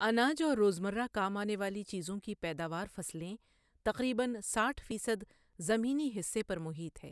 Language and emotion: Urdu, neutral